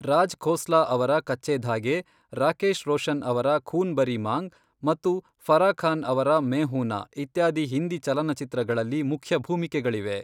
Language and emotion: Kannada, neutral